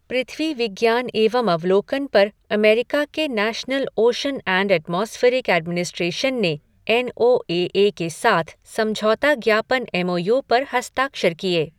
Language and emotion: Hindi, neutral